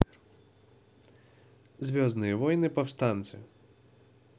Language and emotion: Russian, neutral